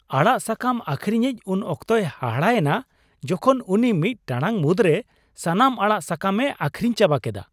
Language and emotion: Santali, surprised